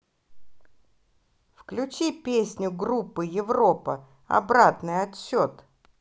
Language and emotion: Russian, positive